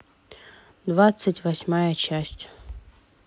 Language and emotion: Russian, neutral